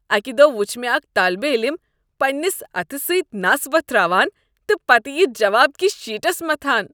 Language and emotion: Kashmiri, disgusted